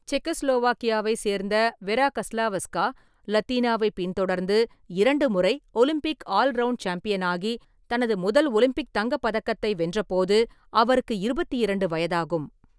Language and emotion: Tamil, neutral